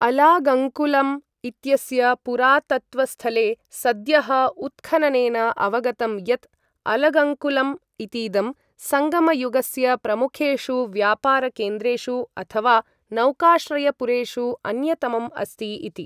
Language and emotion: Sanskrit, neutral